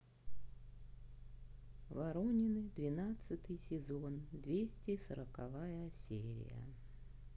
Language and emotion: Russian, neutral